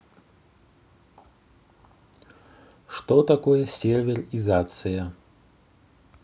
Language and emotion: Russian, neutral